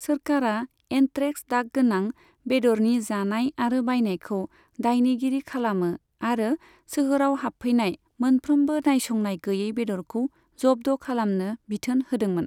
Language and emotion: Bodo, neutral